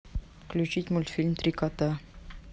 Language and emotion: Russian, neutral